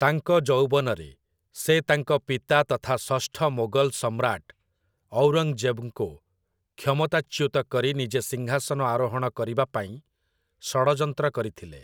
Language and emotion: Odia, neutral